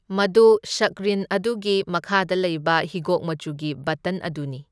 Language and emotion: Manipuri, neutral